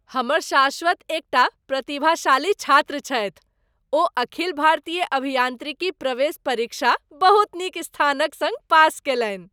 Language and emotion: Maithili, happy